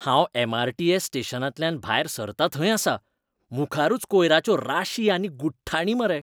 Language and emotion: Goan Konkani, disgusted